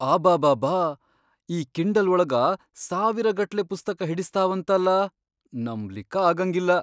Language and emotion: Kannada, surprised